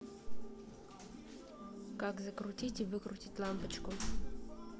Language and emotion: Russian, neutral